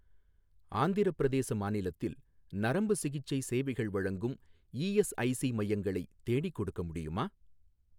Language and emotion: Tamil, neutral